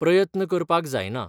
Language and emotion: Goan Konkani, neutral